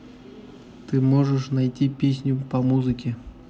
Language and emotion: Russian, neutral